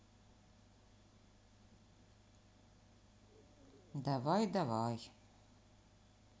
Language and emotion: Russian, sad